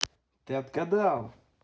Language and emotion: Russian, positive